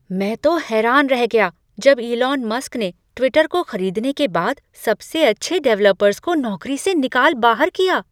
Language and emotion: Hindi, surprised